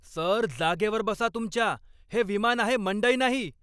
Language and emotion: Marathi, angry